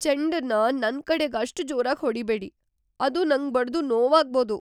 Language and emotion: Kannada, fearful